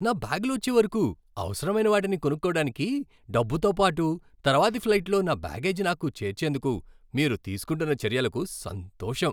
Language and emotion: Telugu, happy